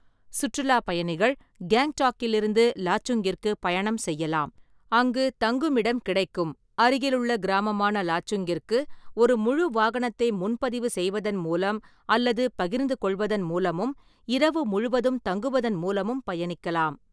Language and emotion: Tamil, neutral